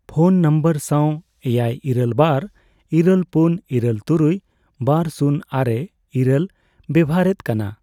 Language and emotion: Santali, neutral